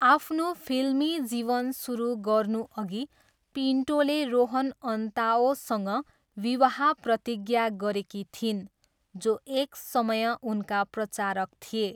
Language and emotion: Nepali, neutral